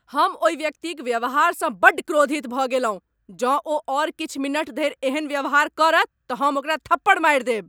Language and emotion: Maithili, angry